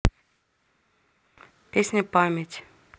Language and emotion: Russian, neutral